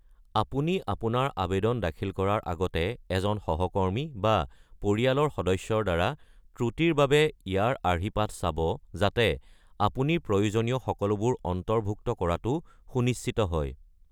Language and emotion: Assamese, neutral